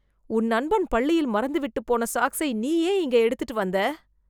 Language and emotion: Tamil, disgusted